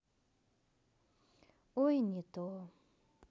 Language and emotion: Russian, sad